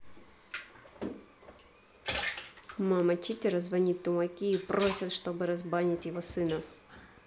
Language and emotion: Russian, angry